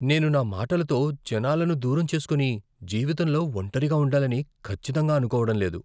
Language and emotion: Telugu, fearful